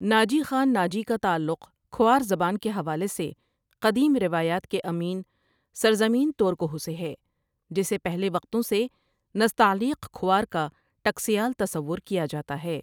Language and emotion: Urdu, neutral